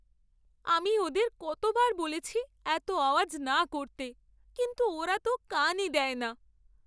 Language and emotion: Bengali, sad